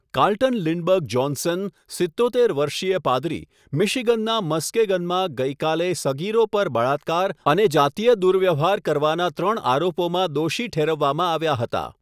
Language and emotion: Gujarati, neutral